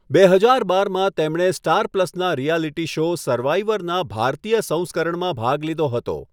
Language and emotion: Gujarati, neutral